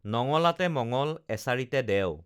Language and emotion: Assamese, neutral